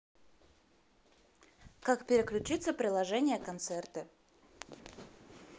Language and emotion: Russian, neutral